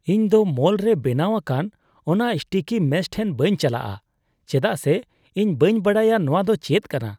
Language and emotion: Santali, disgusted